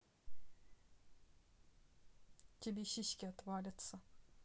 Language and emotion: Russian, neutral